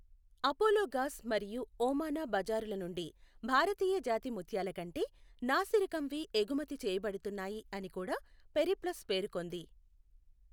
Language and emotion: Telugu, neutral